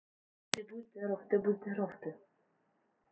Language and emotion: Russian, neutral